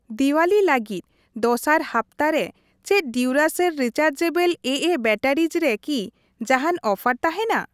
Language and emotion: Santali, neutral